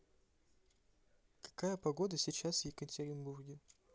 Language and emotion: Russian, neutral